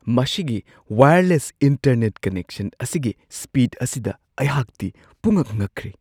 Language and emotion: Manipuri, surprised